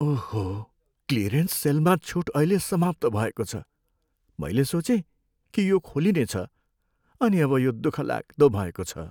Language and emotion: Nepali, sad